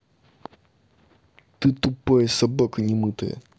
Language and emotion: Russian, angry